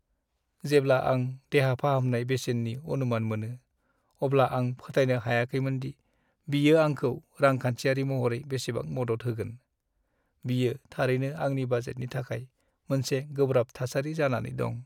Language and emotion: Bodo, sad